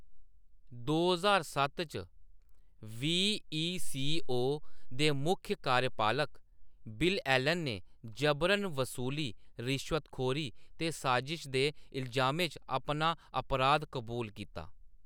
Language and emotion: Dogri, neutral